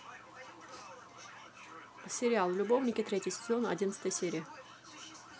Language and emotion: Russian, neutral